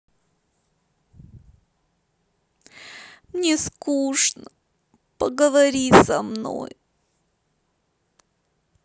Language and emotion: Russian, sad